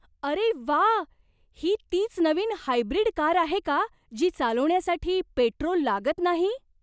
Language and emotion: Marathi, surprised